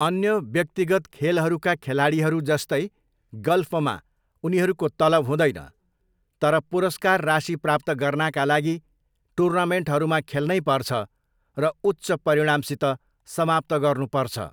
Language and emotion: Nepali, neutral